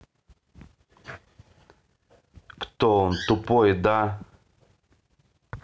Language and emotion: Russian, neutral